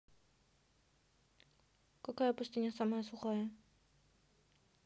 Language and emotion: Russian, neutral